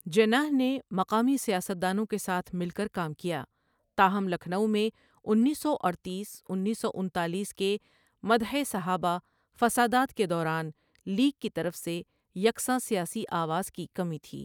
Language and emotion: Urdu, neutral